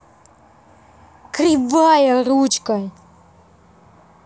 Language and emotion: Russian, angry